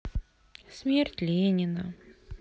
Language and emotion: Russian, sad